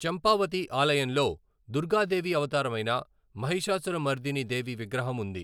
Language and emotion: Telugu, neutral